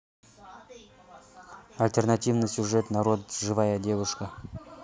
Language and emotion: Russian, neutral